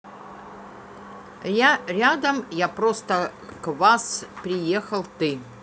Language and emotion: Russian, neutral